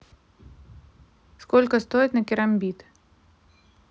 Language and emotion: Russian, neutral